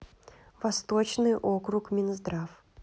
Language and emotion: Russian, neutral